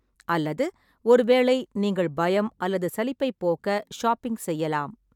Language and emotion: Tamil, neutral